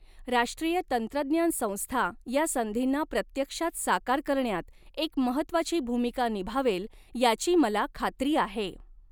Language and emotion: Marathi, neutral